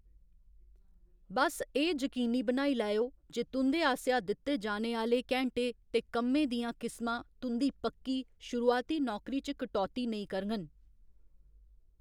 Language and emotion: Dogri, neutral